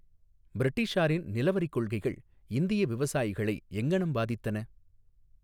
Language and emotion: Tamil, neutral